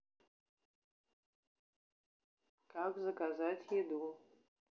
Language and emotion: Russian, neutral